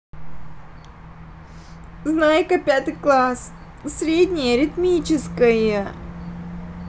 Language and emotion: Russian, sad